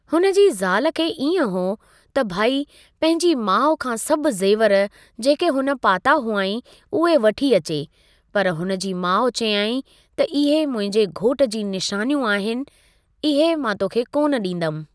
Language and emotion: Sindhi, neutral